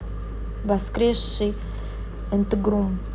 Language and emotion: Russian, neutral